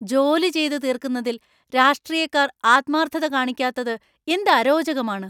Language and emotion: Malayalam, angry